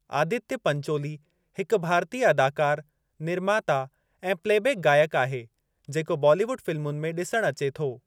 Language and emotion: Sindhi, neutral